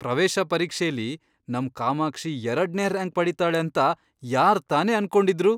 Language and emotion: Kannada, surprised